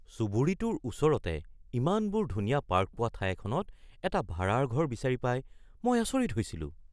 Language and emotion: Assamese, surprised